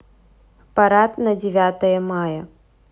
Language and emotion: Russian, neutral